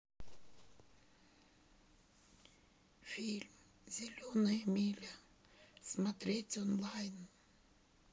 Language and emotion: Russian, sad